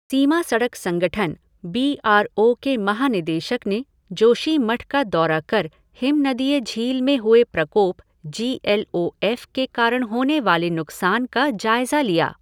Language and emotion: Hindi, neutral